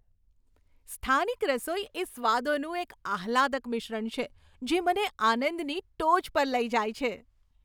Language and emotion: Gujarati, happy